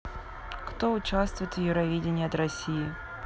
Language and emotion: Russian, neutral